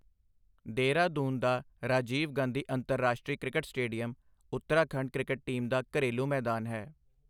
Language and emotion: Punjabi, neutral